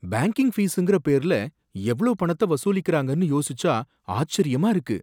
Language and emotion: Tamil, surprised